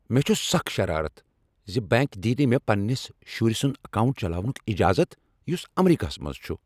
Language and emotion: Kashmiri, angry